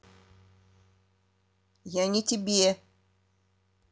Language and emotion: Russian, neutral